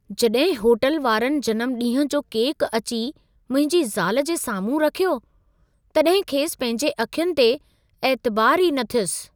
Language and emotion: Sindhi, surprised